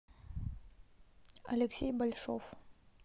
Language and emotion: Russian, neutral